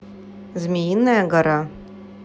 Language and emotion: Russian, neutral